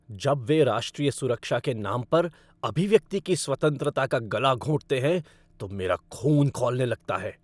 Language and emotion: Hindi, angry